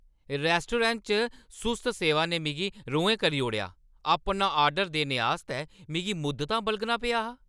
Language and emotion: Dogri, angry